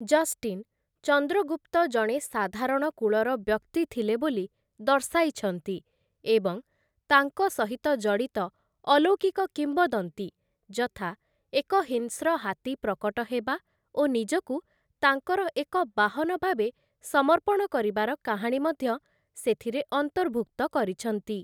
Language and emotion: Odia, neutral